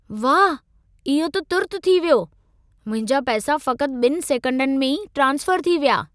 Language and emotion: Sindhi, surprised